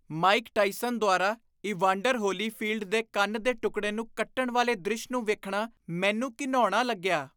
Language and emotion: Punjabi, disgusted